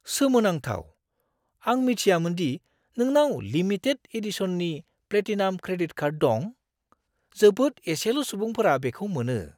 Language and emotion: Bodo, surprised